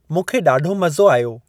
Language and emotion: Sindhi, neutral